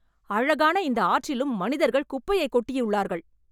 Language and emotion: Tamil, angry